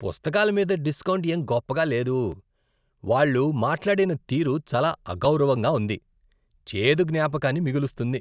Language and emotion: Telugu, disgusted